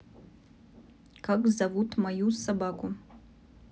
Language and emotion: Russian, neutral